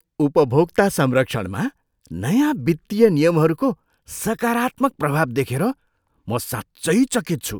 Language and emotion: Nepali, surprised